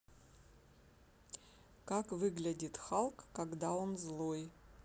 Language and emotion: Russian, neutral